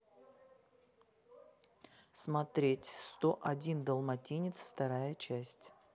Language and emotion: Russian, neutral